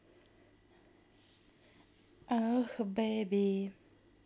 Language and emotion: Russian, neutral